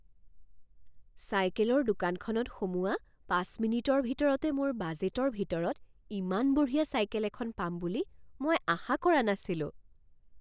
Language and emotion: Assamese, surprised